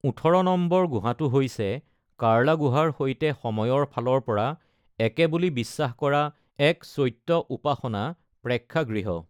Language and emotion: Assamese, neutral